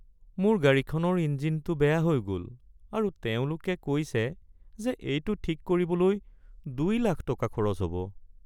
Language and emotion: Assamese, sad